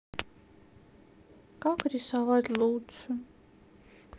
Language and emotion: Russian, sad